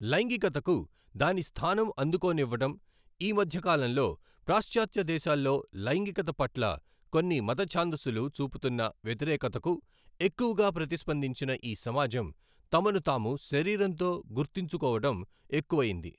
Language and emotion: Telugu, neutral